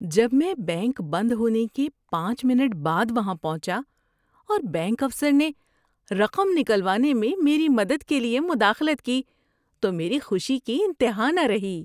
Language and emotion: Urdu, happy